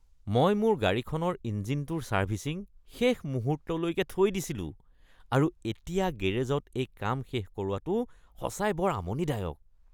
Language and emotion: Assamese, disgusted